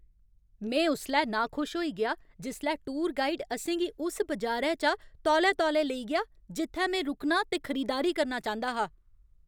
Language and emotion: Dogri, angry